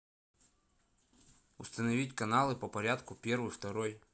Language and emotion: Russian, neutral